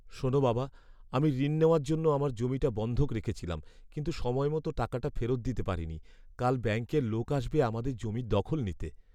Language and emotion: Bengali, sad